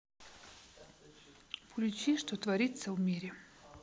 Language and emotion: Russian, neutral